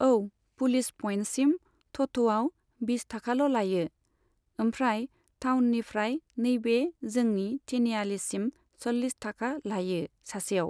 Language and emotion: Bodo, neutral